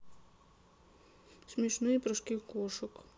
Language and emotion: Russian, sad